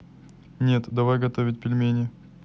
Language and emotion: Russian, neutral